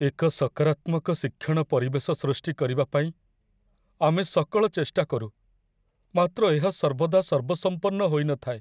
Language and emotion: Odia, sad